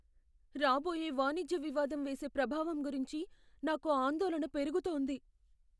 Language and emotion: Telugu, fearful